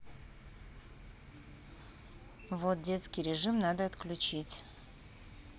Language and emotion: Russian, neutral